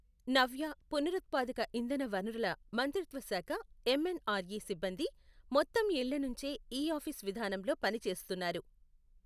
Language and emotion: Telugu, neutral